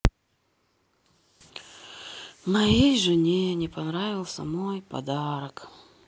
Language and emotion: Russian, sad